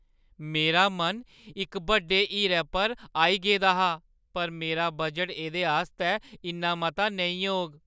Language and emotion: Dogri, sad